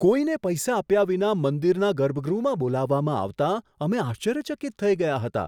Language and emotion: Gujarati, surprised